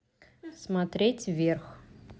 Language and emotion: Russian, neutral